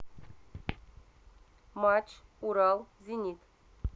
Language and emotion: Russian, neutral